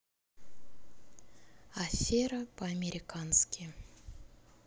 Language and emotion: Russian, neutral